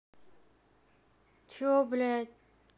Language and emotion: Russian, angry